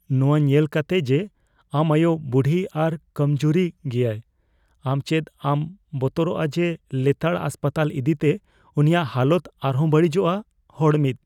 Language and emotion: Santali, fearful